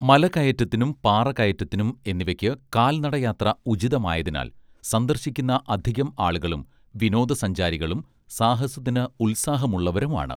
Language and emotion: Malayalam, neutral